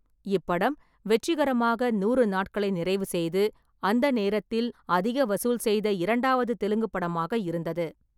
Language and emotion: Tamil, neutral